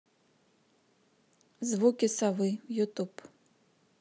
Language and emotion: Russian, neutral